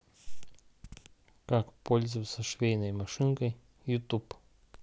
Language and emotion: Russian, neutral